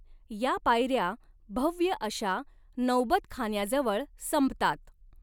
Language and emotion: Marathi, neutral